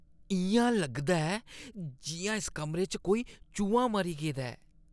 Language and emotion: Dogri, disgusted